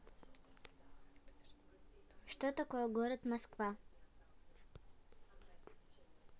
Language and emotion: Russian, neutral